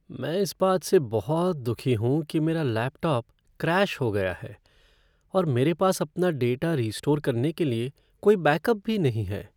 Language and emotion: Hindi, sad